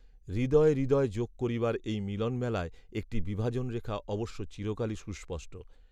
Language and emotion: Bengali, neutral